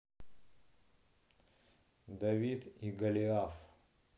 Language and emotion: Russian, neutral